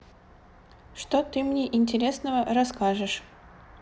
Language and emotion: Russian, neutral